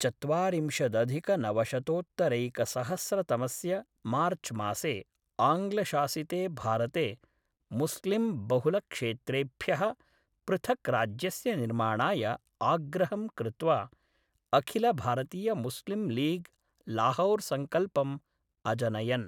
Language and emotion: Sanskrit, neutral